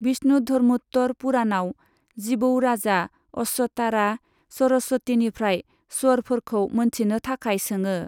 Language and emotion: Bodo, neutral